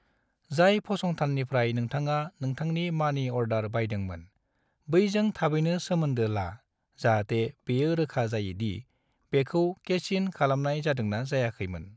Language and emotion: Bodo, neutral